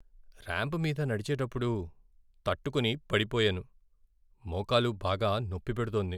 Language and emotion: Telugu, sad